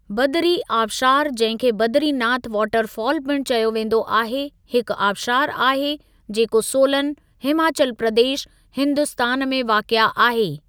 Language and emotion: Sindhi, neutral